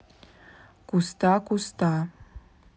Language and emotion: Russian, neutral